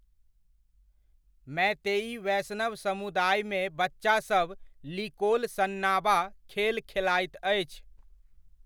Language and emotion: Maithili, neutral